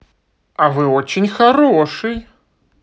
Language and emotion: Russian, positive